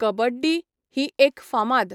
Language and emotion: Goan Konkani, neutral